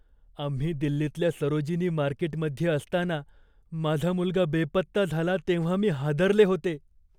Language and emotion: Marathi, fearful